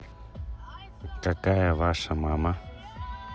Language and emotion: Russian, neutral